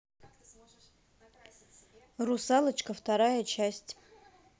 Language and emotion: Russian, neutral